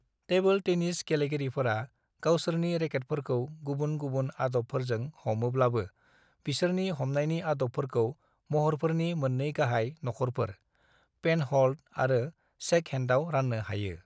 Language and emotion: Bodo, neutral